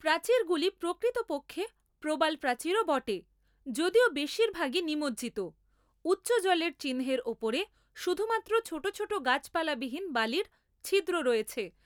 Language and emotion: Bengali, neutral